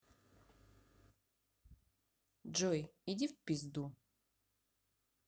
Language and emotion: Russian, neutral